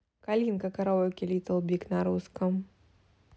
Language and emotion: Russian, neutral